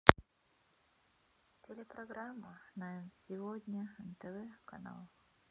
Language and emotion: Russian, sad